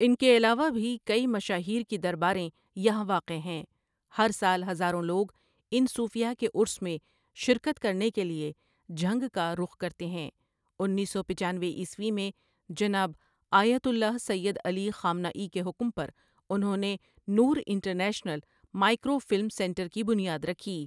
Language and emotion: Urdu, neutral